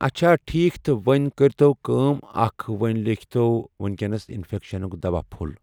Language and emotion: Kashmiri, neutral